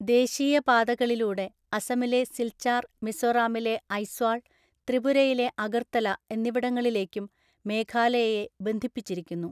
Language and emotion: Malayalam, neutral